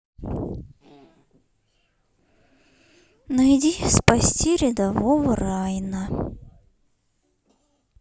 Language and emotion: Russian, sad